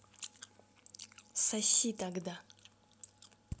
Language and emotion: Russian, angry